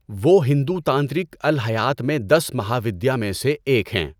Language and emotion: Urdu, neutral